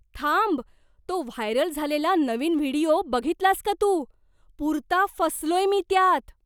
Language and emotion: Marathi, surprised